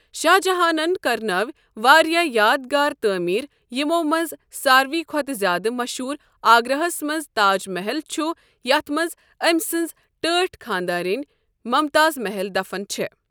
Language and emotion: Kashmiri, neutral